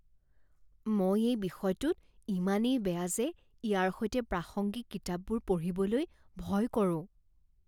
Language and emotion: Assamese, fearful